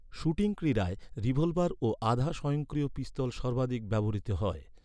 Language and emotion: Bengali, neutral